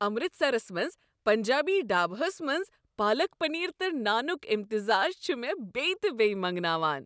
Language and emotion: Kashmiri, happy